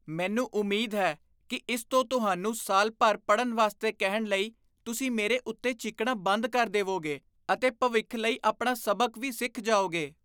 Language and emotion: Punjabi, disgusted